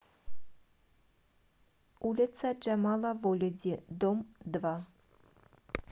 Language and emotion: Russian, neutral